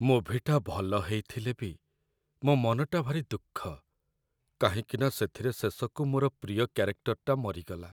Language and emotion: Odia, sad